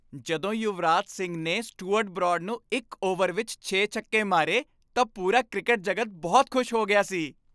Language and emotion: Punjabi, happy